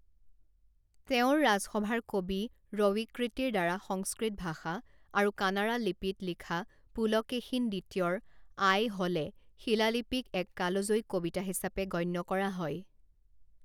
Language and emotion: Assamese, neutral